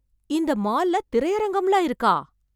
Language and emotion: Tamil, surprised